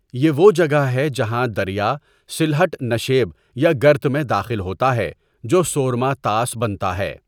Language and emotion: Urdu, neutral